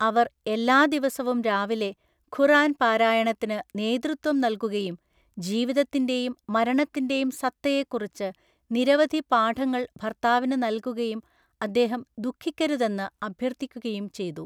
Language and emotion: Malayalam, neutral